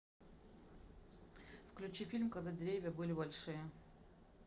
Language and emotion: Russian, neutral